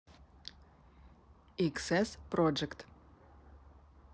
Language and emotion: Russian, neutral